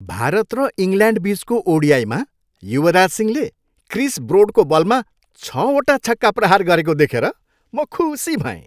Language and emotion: Nepali, happy